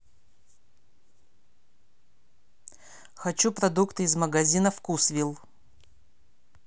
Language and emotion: Russian, neutral